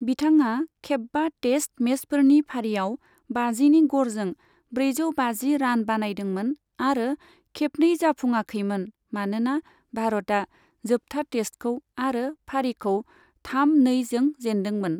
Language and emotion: Bodo, neutral